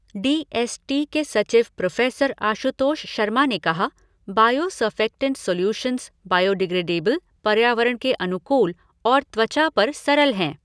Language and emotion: Hindi, neutral